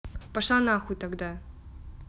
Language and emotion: Russian, angry